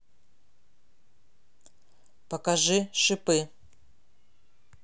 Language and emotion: Russian, neutral